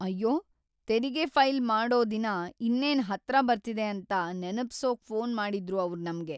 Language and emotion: Kannada, sad